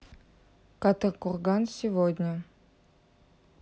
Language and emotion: Russian, neutral